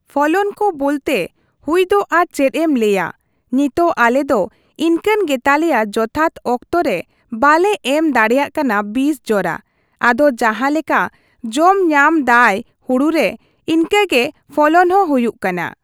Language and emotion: Santali, neutral